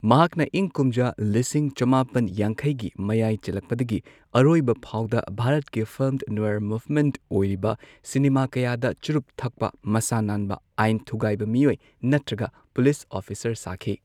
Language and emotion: Manipuri, neutral